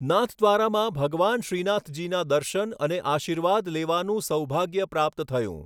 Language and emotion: Gujarati, neutral